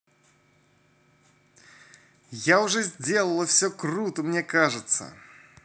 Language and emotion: Russian, positive